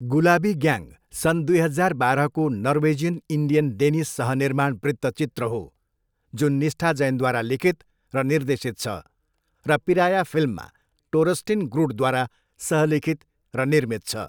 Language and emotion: Nepali, neutral